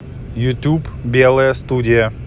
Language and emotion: Russian, neutral